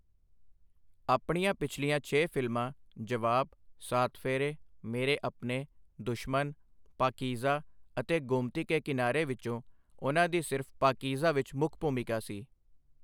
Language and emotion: Punjabi, neutral